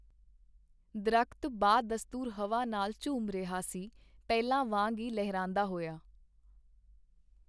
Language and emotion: Punjabi, neutral